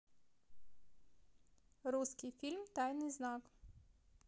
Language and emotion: Russian, neutral